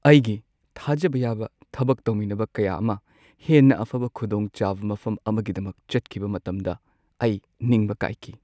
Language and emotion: Manipuri, sad